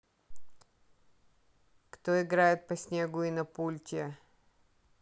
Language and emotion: Russian, neutral